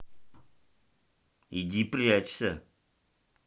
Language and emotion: Russian, angry